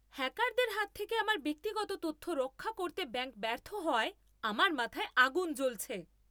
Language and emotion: Bengali, angry